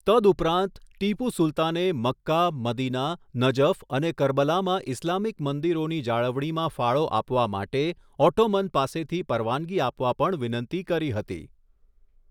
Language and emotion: Gujarati, neutral